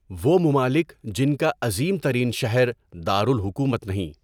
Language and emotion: Urdu, neutral